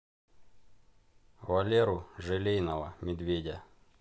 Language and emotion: Russian, neutral